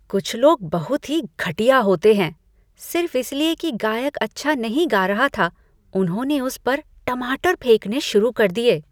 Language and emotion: Hindi, disgusted